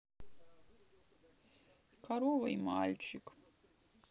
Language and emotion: Russian, sad